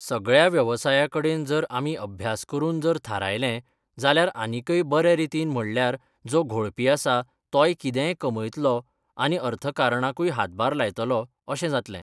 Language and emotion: Goan Konkani, neutral